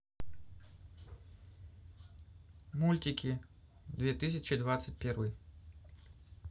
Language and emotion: Russian, neutral